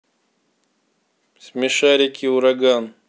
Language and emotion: Russian, neutral